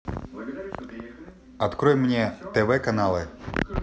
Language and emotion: Russian, neutral